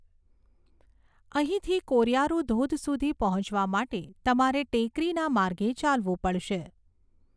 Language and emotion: Gujarati, neutral